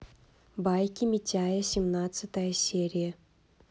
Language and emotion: Russian, neutral